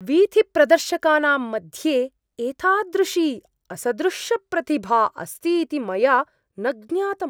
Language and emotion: Sanskrit, surprised